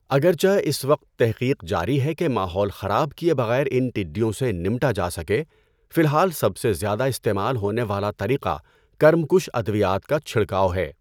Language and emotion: Urdu, neutral